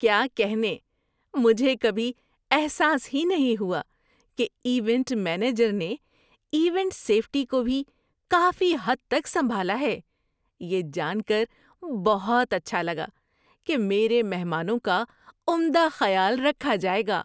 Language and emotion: Urdu, surprised